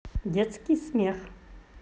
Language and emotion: Russian, positive